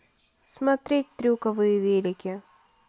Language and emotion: Russian, neutral